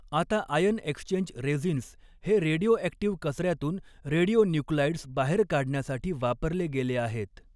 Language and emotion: Marathi, neutral